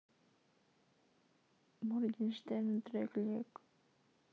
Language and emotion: Russian, sad